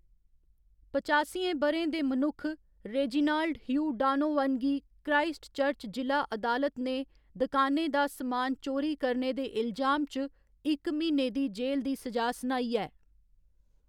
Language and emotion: Dogri, neutral